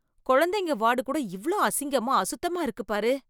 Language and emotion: Tamil, disgusted